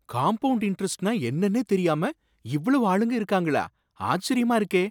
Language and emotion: Tamil, surprised